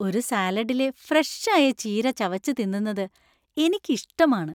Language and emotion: Malayalam, happy